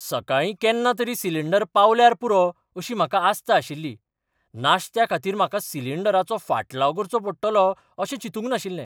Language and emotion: Goan Konkani, surprised